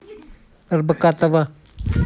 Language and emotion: Russian, neutral